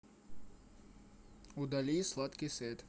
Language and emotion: Russian, neutral